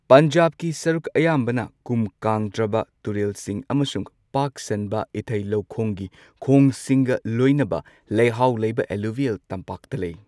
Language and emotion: Manipuri, neutral